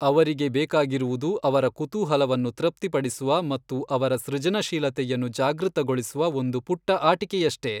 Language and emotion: Kannada, neutral